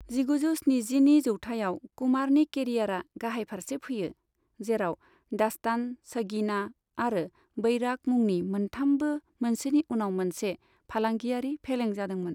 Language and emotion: Bodo, neutral